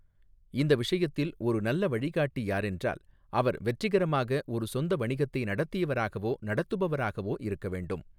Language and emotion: Tamil, neutral